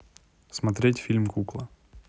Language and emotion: Russian, neutral